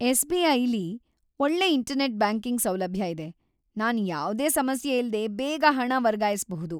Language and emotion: Kannada, happy